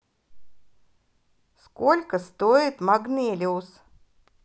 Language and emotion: Russian, positive